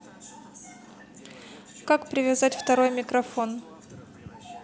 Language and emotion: Russian, neutral